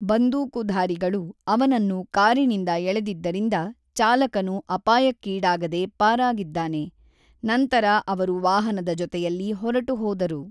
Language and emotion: Kannada, neutral